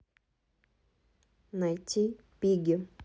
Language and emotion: Russian, neutral